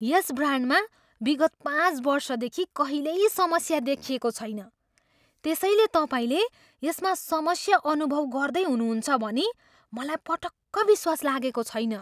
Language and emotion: Nepali, surprised